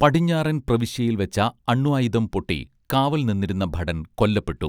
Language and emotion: Malayalam, neutral